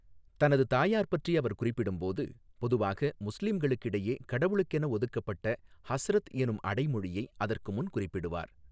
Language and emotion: Tamil, neutral